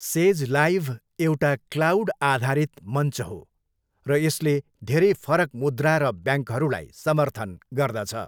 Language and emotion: Nepali, neutral